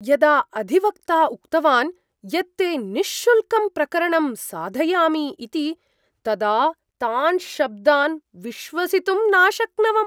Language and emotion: Sanskrit, surprised